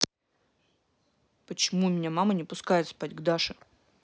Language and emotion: Russian, angry